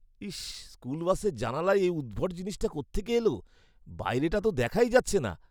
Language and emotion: Bengali, disgusted